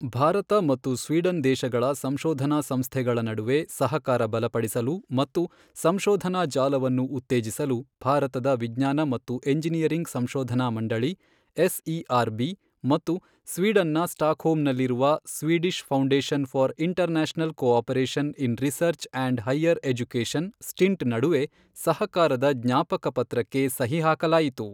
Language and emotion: Kannada, neutral